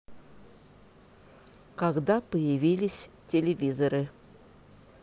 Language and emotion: Russian, neutral